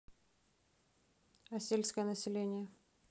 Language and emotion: Russian, neutral